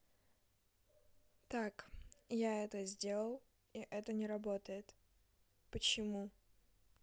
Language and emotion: Russian, neutral